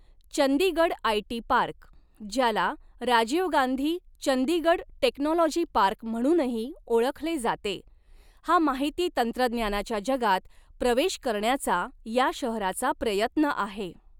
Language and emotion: Marathi, neutral